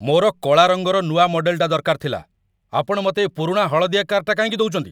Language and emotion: Odia, angry